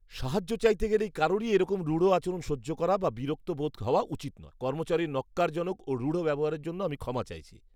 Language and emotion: Bengali, disgusted